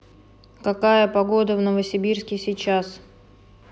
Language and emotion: Russian, neutral